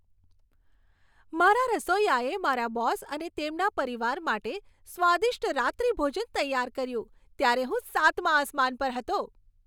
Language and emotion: Gujarati, happy